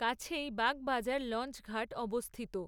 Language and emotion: Bengali, neutral